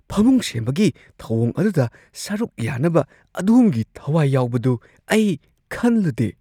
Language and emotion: Manipuri, surprised